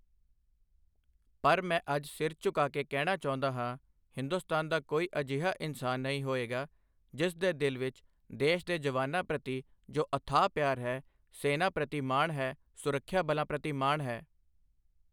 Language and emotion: Punjabi, neutral